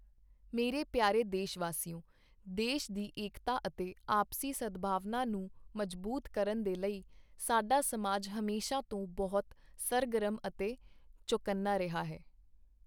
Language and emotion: Punjabi, neutral